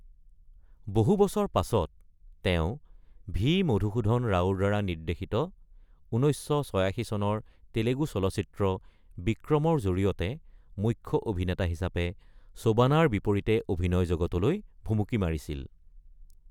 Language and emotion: Assamese, neutral